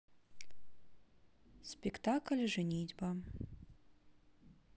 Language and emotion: Russian, neutral